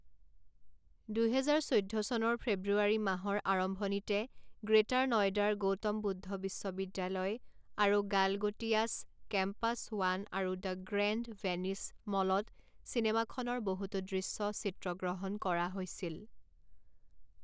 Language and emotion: Assamese, neutral